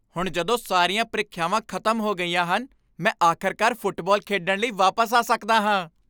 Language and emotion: Punjabi, happy